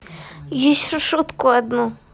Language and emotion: Russian, neutral